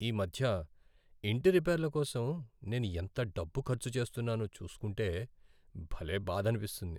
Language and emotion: Telugu, sad